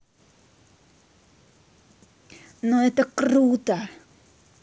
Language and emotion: Russian, positive